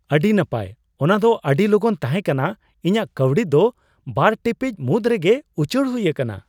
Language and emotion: Santali, surprised